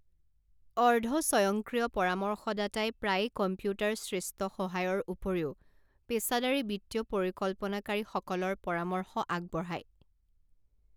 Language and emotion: Assamese, neutral